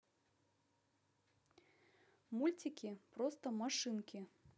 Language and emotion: Russian, positive